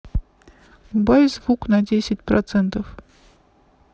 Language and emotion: Russian, neutral